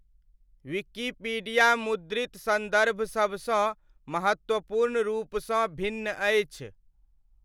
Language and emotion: Maithili, neutral